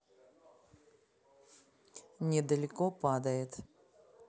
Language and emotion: Russian, neutral